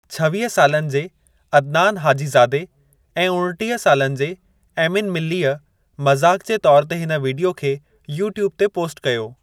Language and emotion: Sindhi, neutral